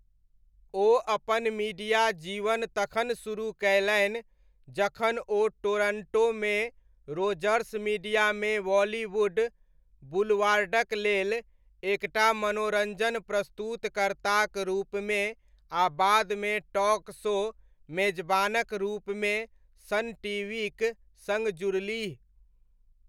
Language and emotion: Maithili, neutral